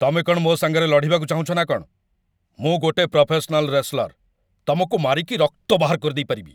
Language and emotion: Odia, angry